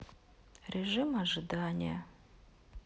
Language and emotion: Russian, sad